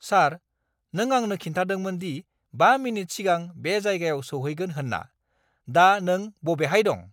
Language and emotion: Bodo, angry